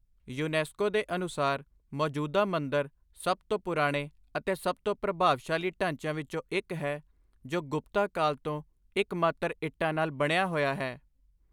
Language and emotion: Punjabi, neutral